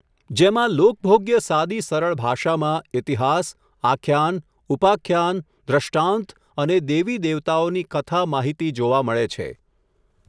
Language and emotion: Gujarati, neutral